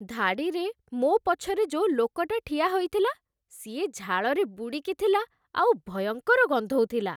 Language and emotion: Odia, disgusted